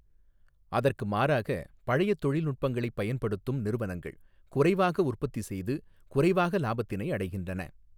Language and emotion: Tamil, neutral